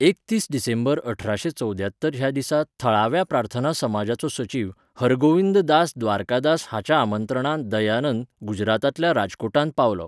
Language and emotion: Goan Konkani, neutral